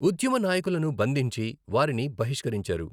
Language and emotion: Telugu, neutral